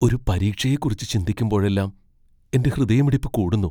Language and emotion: Malayalam, fearful